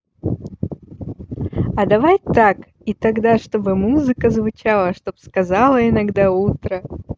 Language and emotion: Russian, positive